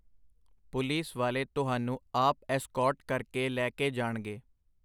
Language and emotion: Punjabi, neutral